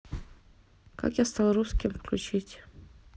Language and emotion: Russian, neutral